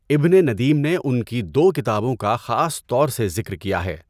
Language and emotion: Urdu, neutral